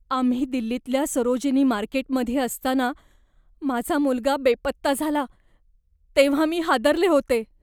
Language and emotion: Marathi, fearful